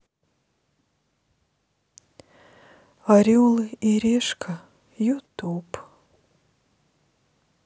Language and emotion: Russian, sad